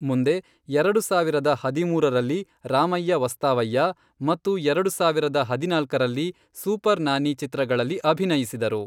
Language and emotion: Kannada, neutral